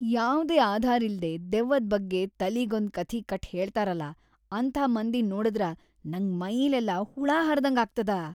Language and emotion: Kannada, disgusted